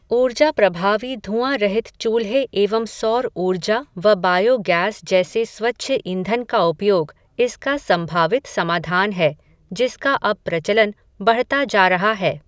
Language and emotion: Hindi, neutral